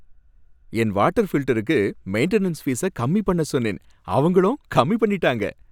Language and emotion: Tamil, happy